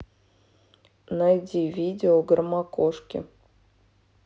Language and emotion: Russian, neutral